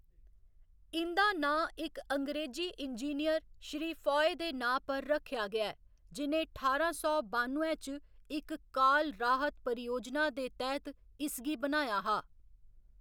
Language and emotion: Dogri, neutral